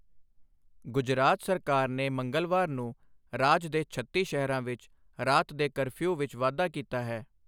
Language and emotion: Punjabi, neutral